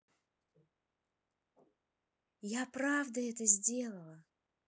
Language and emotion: Russian, positive